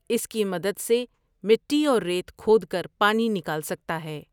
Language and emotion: Urdu, neutral